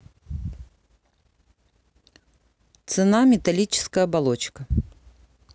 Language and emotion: Russian, neutral